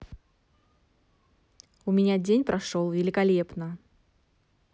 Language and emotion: Russian, positive